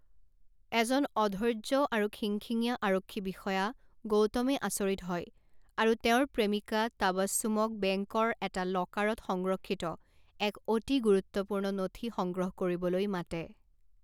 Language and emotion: Assamese, neutral